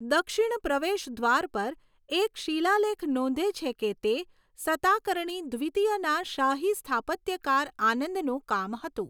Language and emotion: Gujarati, neutral